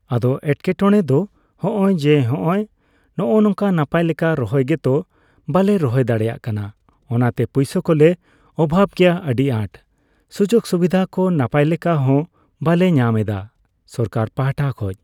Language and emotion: Santali, neutral